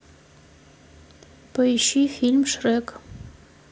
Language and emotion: Russian, neutral